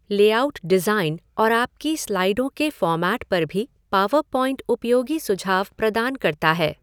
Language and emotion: Hindi, neutral